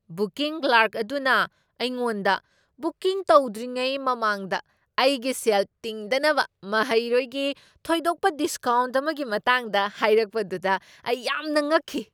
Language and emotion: Manipuri, surprised